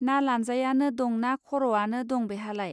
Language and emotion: Bodo, neutral